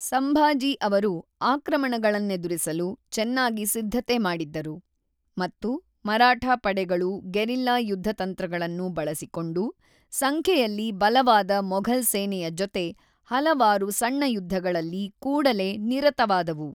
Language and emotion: Kannada, neutral